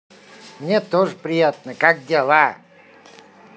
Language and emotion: Russian, positive